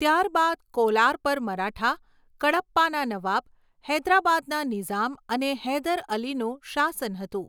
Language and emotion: Gujarati, neutral